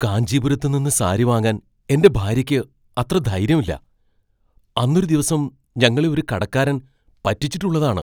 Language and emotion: Malayalam, fearful